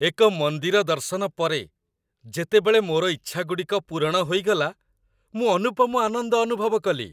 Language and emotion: Odia, happy